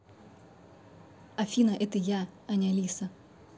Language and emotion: Russian, neutral